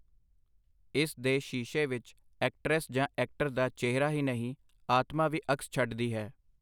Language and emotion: Punjabi, neutral